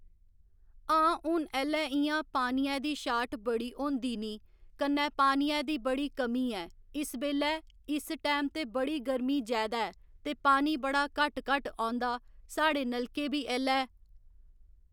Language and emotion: Dogri, neutral